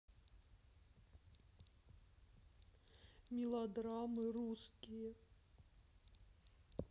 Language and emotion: Russian, sad